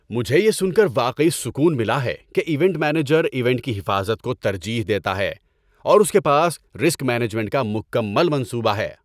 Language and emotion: Urdu, happy